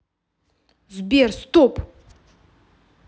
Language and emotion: Russian, angry